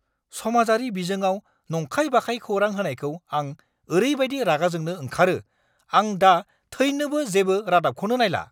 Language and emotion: Bodo, angry